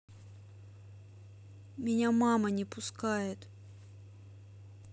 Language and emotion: Russian, sad